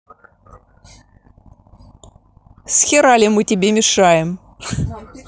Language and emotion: Russian, angry